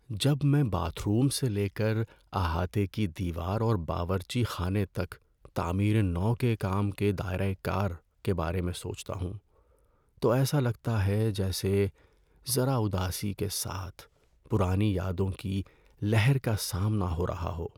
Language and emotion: Urdu, sad